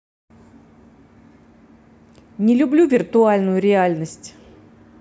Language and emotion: Russian, angry